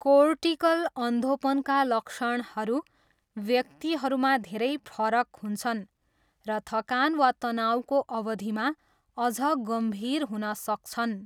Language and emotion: Nepali, neutral